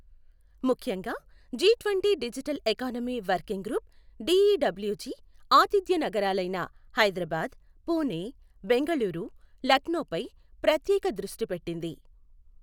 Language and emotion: Telugu, neutral